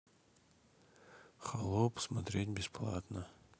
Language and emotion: Russian, neutral